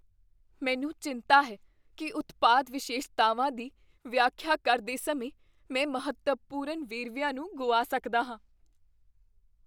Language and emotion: Punjabi, fearful